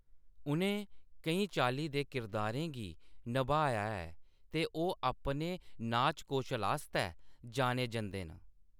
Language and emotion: Dogri, neutral